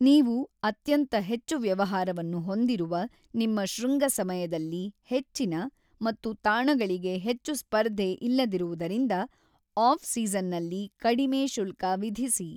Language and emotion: Kannada, neutral